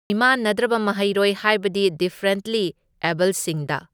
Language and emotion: Manipuri, neutral